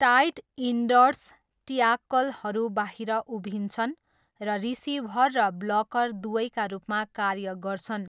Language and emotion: Nepali, neutral